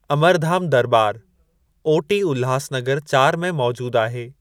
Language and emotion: Sindhi, neutral